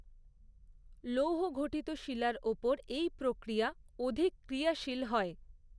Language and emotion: Bengali, neutral